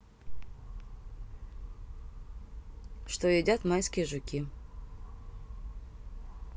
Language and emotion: Russian, neutral